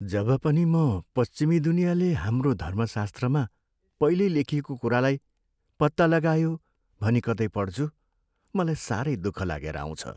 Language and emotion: Nepali, sad